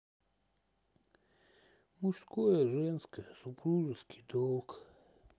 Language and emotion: Russian, sad